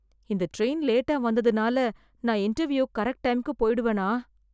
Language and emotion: Tamil, fearful